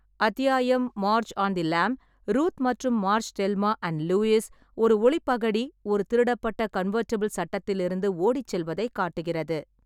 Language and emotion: Tamil, neutral